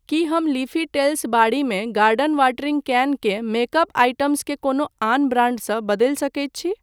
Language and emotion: Maithili, neutral